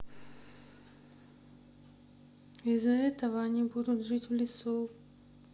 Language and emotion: Russian, sad